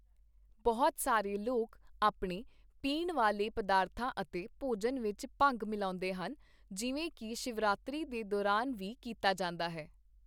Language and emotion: Punjabi, neutral